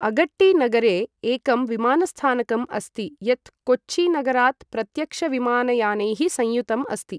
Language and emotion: Sanskrit, neutral